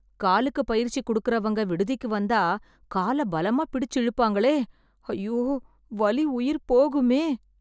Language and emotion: Tamil, fearful